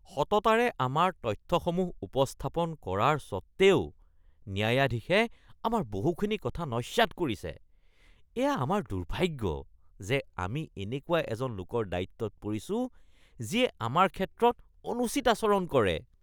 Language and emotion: Assamese, disgusted